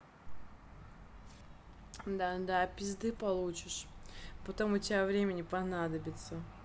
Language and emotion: Russian, angry